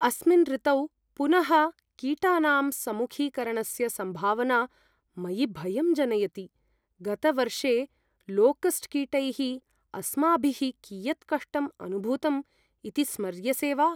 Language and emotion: Sanskrit, fearful